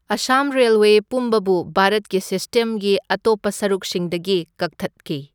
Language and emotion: Manipuri, neutral